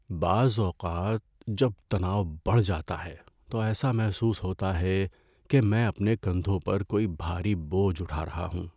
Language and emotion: Urdu, sad